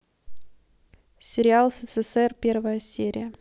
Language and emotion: Russian, neutral